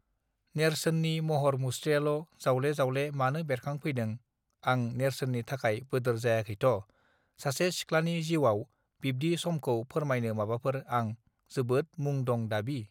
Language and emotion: Bodo, neutral